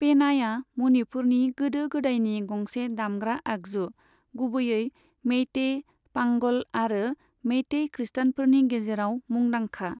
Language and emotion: Bodo, neutral